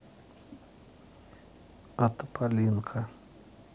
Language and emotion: Russian, neutral